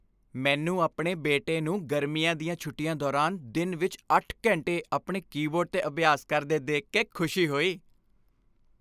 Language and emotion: Punjabi, happy